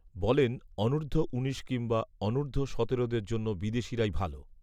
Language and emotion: Bengali, neutral